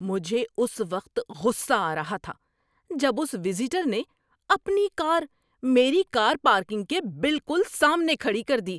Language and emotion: Urdu, angry